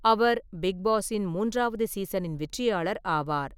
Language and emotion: Tamil, neutral